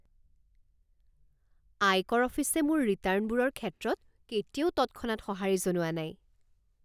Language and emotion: Assamese, surprised